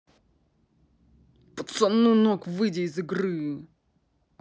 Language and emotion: Russian, angry